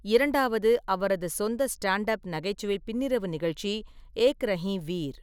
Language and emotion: Tamil, neutral